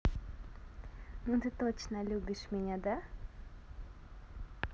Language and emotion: Russian, positive